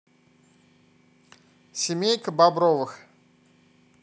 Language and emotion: Russian, neutral